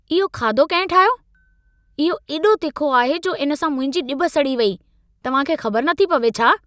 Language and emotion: Sindhi, angry